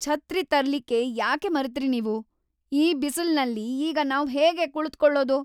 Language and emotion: Kannada, angry